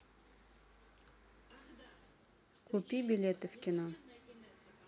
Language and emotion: Russian, neutral